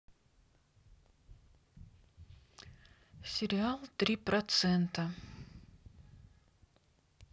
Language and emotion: Russian, neutral